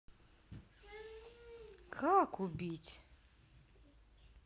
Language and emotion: Russian, neutral